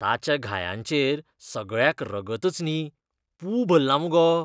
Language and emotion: Goan Konkani, disgusted